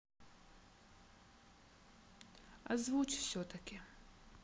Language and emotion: Russian, sad